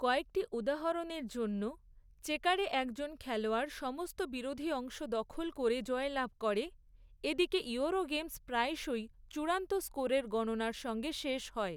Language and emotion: Bengali, neutral